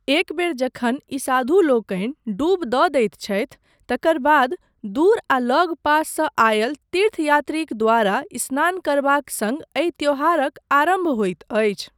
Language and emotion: Maithili, neutral